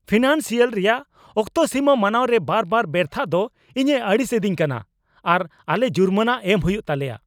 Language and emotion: Santali, angry